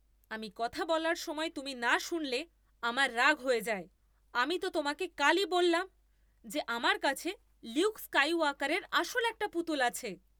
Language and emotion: Bengali, angry